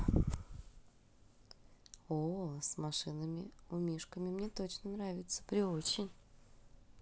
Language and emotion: Russian, positive